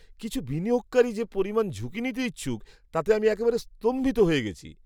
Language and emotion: Bengali, surprised